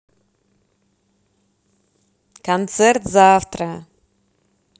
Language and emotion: Russian, positive